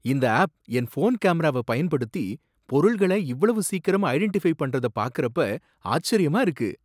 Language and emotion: Tamil, surprised